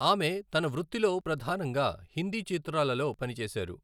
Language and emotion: Telugu, neutral